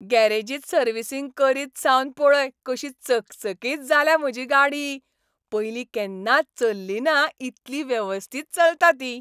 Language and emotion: Goan Konkani, happy